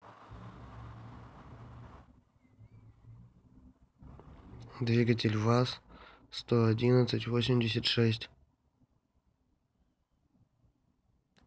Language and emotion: Russian, neutral